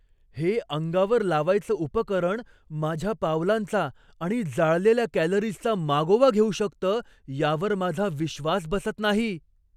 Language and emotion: Marathi, surprised